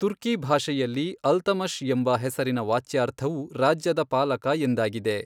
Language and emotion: Kannada, neutral